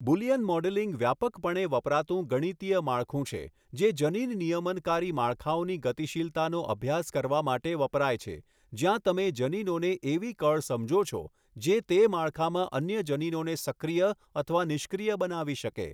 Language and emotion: Gujarati, neutral